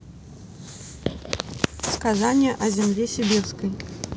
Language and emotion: Russian, neutral